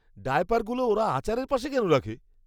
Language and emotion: Bengali, disgusted